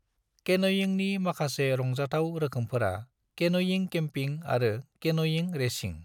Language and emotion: Bodo, neutral